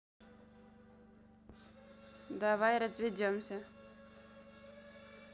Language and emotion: Russian, neutral